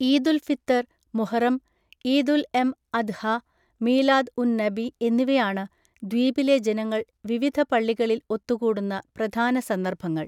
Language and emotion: Malayalam, neutral